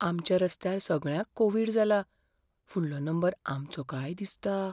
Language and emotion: Goan Konkani, fearful